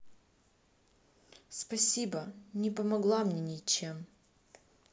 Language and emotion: Russian, sad